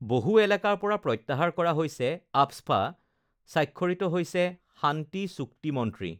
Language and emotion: Assamese, neutral